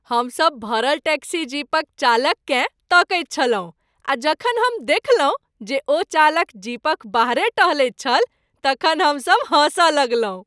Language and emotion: Maithili, happy